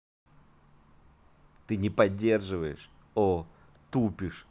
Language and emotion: Russian, angry